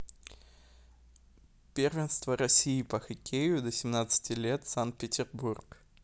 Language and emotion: Russian, neutral